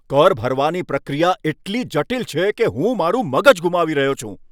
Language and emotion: Gujarati, angry